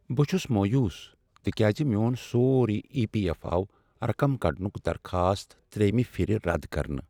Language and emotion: Kashmiri, sad